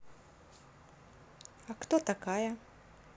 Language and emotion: Russian, neutral